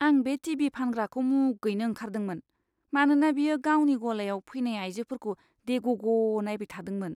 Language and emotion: Bodo, disgusted